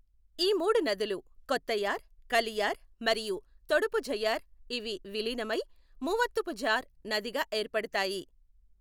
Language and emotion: Telugu, neutral